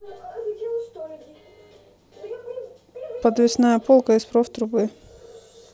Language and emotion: Russian, neutral